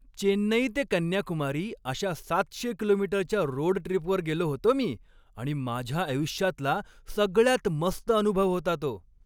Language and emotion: Marathi, happy